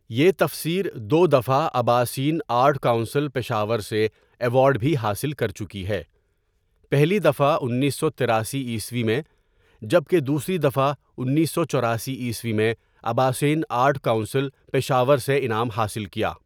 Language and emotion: Urdu, neutral